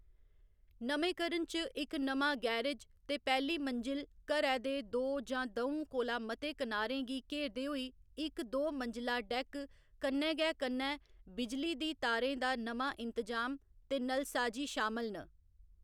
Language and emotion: Dogri, neutral